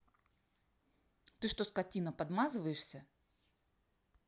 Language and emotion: Russian, angry